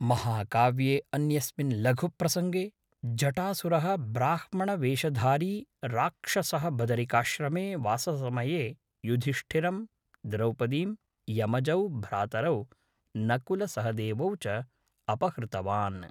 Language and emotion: Sanskrit, neutral